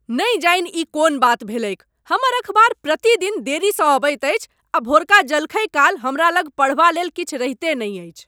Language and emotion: Maithili, angry